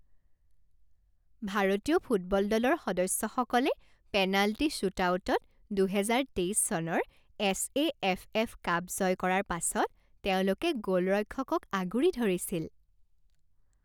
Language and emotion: Assamese, happy